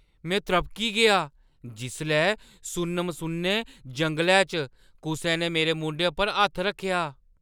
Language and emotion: Dogri, surprised